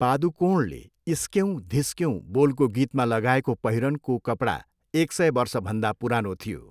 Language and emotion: Nepali, neutral